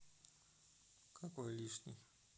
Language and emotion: Russian, neutral